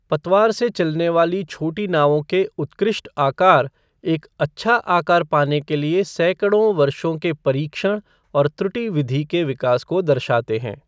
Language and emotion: Hindi, neutral